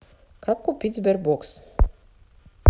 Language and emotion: Russian, neutral